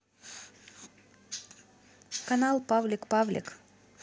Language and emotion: Russian, neutral